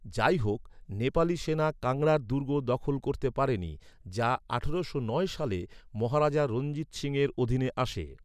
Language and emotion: Bengali, neutral